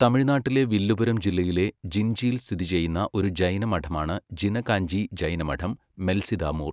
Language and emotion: Malayalam, neutral